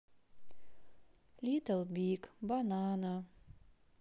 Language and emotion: Russian, sad